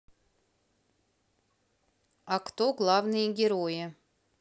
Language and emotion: Russian, neutral